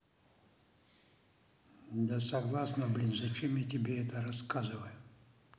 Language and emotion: Russian, angry